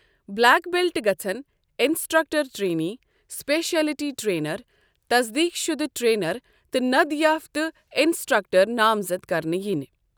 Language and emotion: Kashmiri, neutral